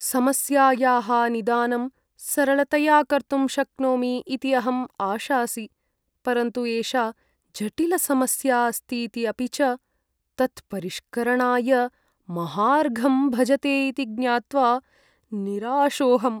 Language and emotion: Sanskrit, sad